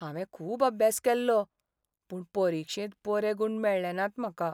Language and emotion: Goan Konkani, sad